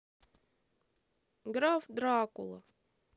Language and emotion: Russian, sad